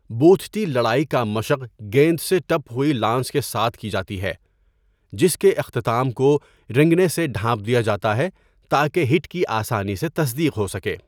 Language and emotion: Urdu, neutral